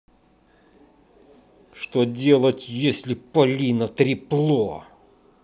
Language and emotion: Russian, angry